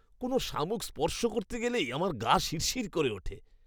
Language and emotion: Bengali, disgusted